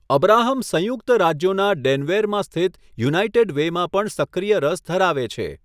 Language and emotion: Gujarati, neutral